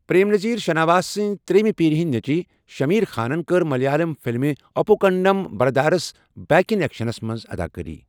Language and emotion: Kashmiri, neutral